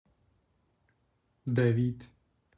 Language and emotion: Russian, neutral